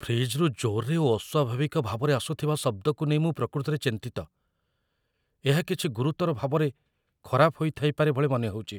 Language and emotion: Odia, fearful